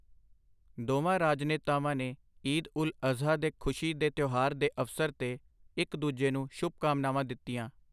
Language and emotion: Punjabi, neutral